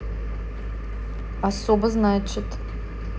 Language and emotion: Russian, neutral